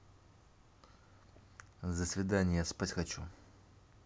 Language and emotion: Russian, neutral